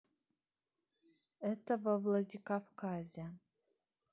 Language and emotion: Russian, neutral